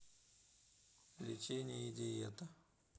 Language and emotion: Russian, neutral